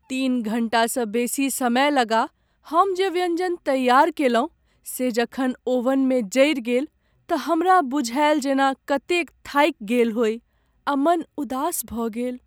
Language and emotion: Maithili, sad